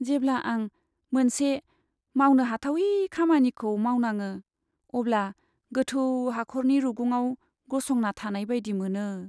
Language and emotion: Bodo, sad